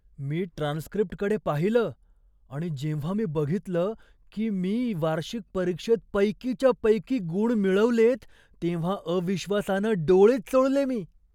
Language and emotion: Marathi, surprised